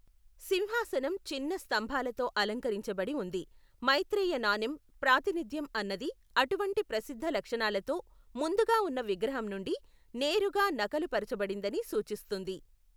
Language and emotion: Telugu, neutral